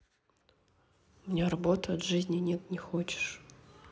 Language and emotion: Russian, sad